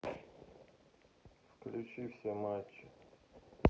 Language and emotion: Russian, sad